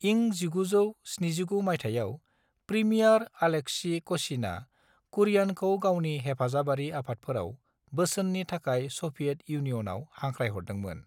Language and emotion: Bodo, neutral